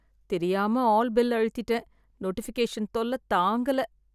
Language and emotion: Tamil, sad